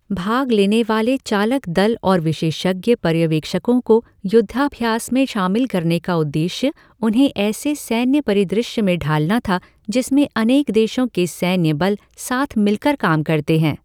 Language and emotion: Hindi, neutral